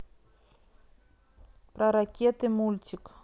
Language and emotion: Russian, neutral